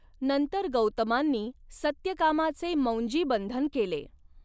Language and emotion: Marathi, neutral